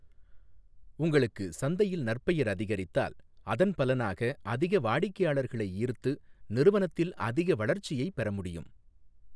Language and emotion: Tamil, neutral